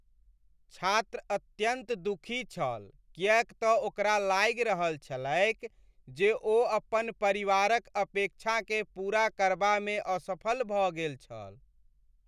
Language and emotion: Maithili, sad